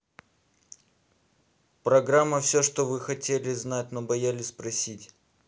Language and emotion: Russian, neutral